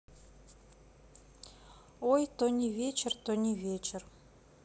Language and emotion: Russian, neutral